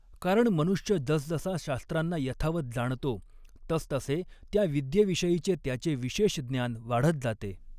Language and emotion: Marathi, neutral